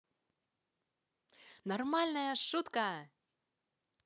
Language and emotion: Russian, positive